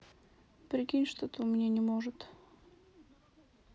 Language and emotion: Russian, sad